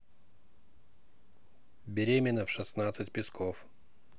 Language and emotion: Russian, neutral